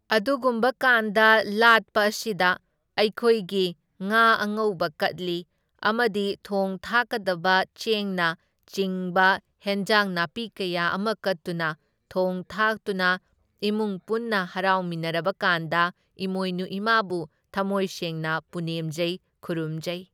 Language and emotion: Manipuri, neutral